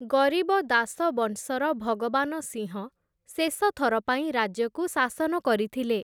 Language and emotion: Odia, neutral